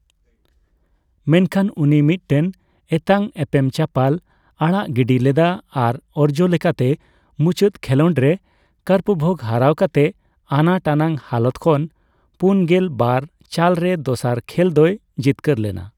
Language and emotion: Santali, neutral